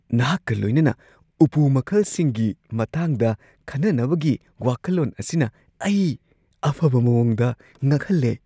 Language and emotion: Manipuri, surprised